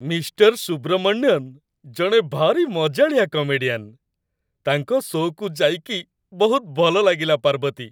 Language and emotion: Odia, happy